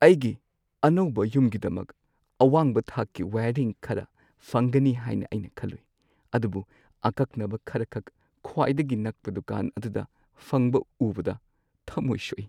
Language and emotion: Manipuri, sad